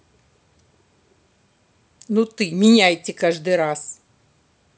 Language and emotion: Russian, angry